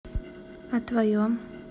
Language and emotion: Russian, neutral